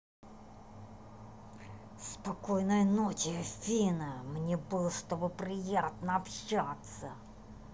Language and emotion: Russian, angry